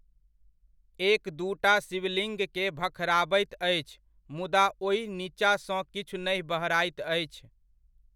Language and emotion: Maithili, neutral